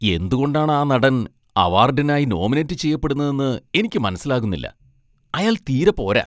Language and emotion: Malayalam, disgusted